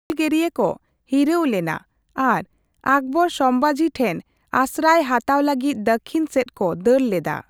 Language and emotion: Santali, neutral